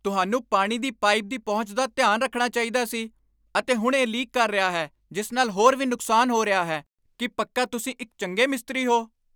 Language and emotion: Punjabi, angry